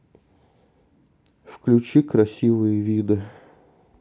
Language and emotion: Russian, sad